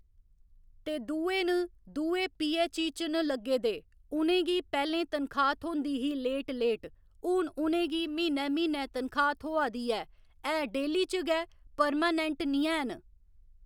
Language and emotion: Dogri, neutral